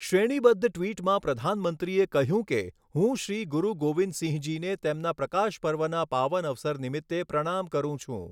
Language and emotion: Gujarati, neutral